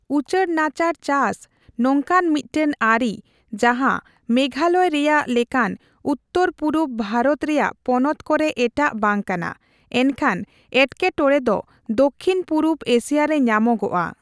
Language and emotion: Santali, neutral